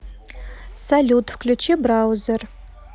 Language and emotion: Russian, neutral